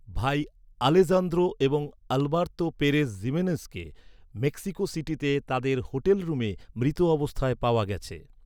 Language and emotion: Bengali, neutral